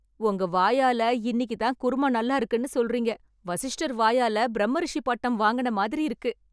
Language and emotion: Tamil, happy